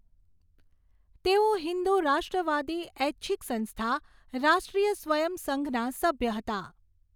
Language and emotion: Gujarati, neutral